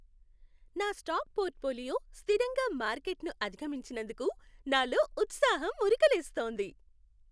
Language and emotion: Telugu, happy